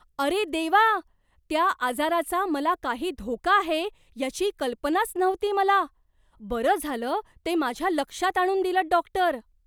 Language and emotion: Marathi, surprised